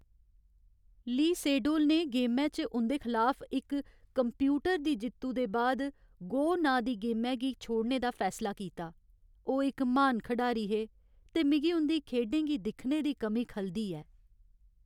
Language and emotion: Dogri, sad